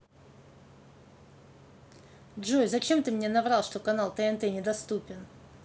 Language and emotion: Russian, angry